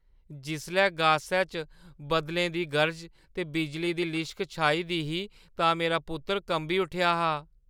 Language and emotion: Dogri, fearful